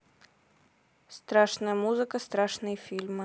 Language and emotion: Russian, neutral